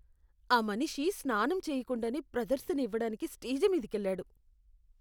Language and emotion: Telugu, disgusted